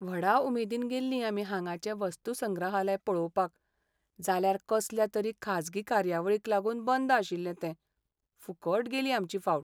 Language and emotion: Goan Konkani, sad